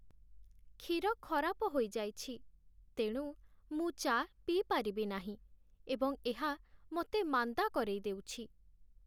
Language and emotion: Odia, sad